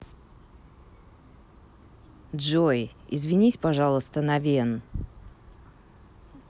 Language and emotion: Russian, neutral